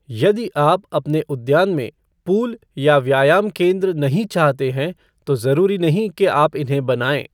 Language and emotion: Hindi, neutral